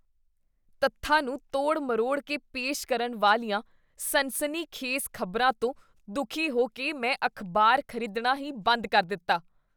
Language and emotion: Punjabi, disgusted